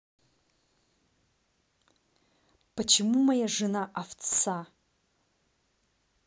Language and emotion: Russian, angry